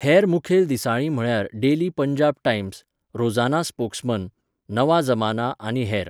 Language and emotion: Goan Konkani, neutral